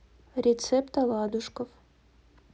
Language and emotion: Russian, neutral